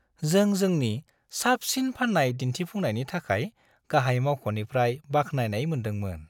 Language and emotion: Bodo, happy